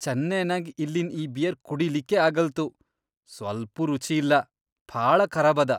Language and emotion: Kannada, disgusted